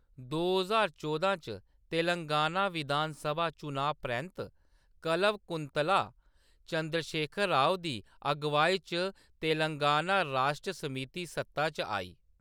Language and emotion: Dogri, neutral